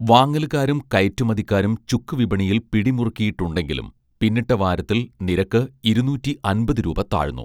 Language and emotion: Malayalam, neutral